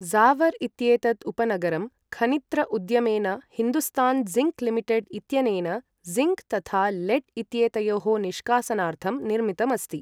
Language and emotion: Sanskrit, neutral